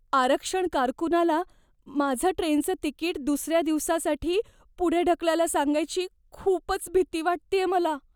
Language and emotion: Marathi, fearful